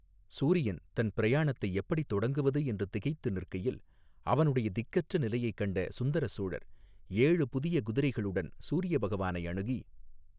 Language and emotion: Tamil, neutral